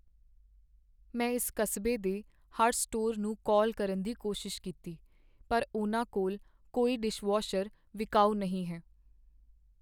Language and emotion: Punjabi, sad